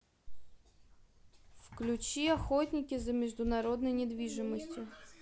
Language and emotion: Russian, neutral